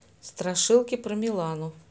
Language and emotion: Russian, neutral